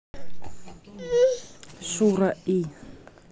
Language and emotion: Russian, neutral